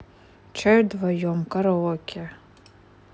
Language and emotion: Russian, neutral